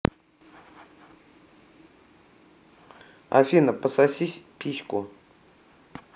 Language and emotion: Russian, neutral